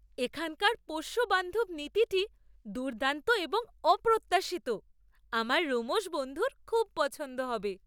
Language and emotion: Bengali, surprised